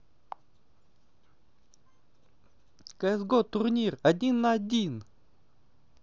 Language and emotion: Russian, positive